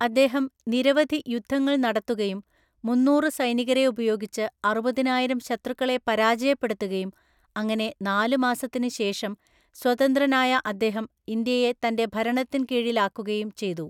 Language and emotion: Malayalam, neutral